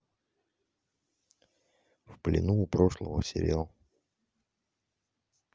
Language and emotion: Russian, neutral